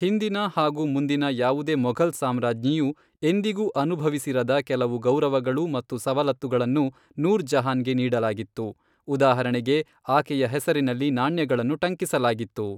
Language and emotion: Kannada, neutral